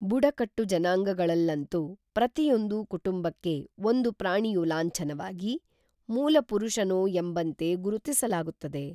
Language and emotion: Kannada, neutral